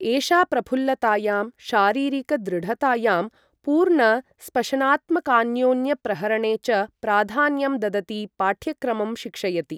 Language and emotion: Sanskrit, neutral